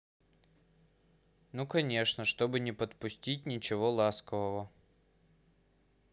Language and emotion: Russian, neutral